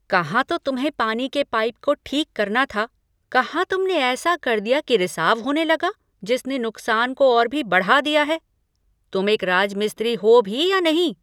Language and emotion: Hindi, angry